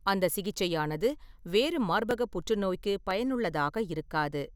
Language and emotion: Tamil, neutral